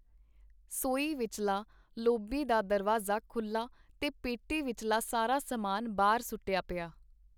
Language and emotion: Punjabi, neutral